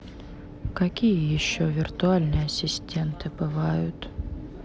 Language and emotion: Russian, sad